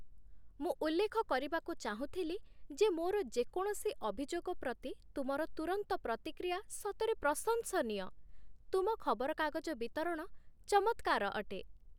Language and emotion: Odia, happy